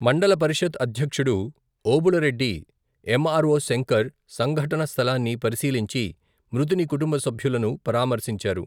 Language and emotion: Telugu, neutral